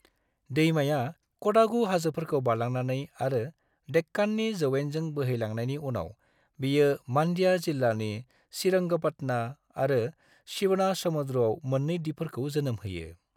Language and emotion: Bodo, neutral